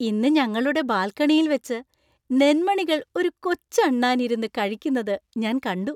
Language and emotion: Malayalam, happy